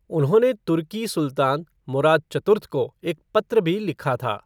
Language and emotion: Hindi, neutral